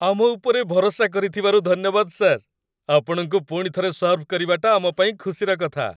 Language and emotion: Odia, happy